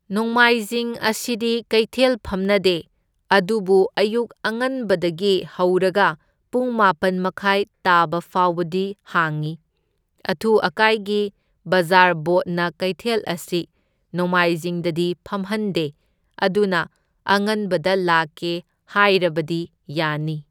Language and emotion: Manipuri, neutral